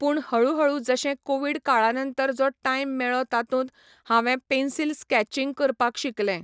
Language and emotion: Goan Konkani, neutral